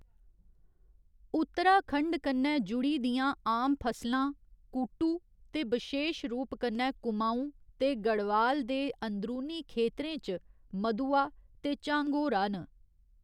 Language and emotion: Dogri, neutral